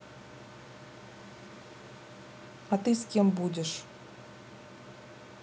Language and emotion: Russian, neutral